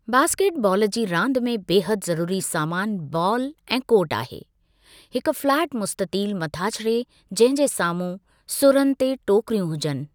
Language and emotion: Sindhi, neutral